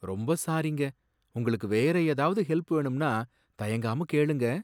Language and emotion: Tamil, sad